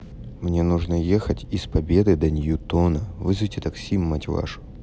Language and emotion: Russian, neutral